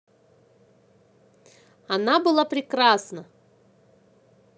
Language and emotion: Russian, positive